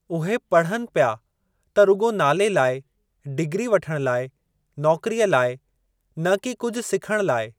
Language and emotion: Sindhi, neutral